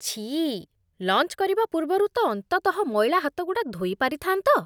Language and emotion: Odia, disgusted